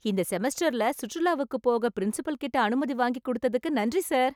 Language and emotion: Tamil, happy